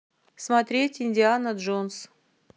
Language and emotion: Russian, neutral